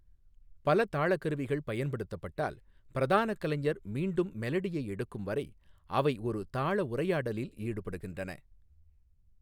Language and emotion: Tamil, neutral